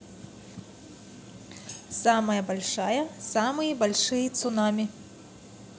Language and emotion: Russian, neutral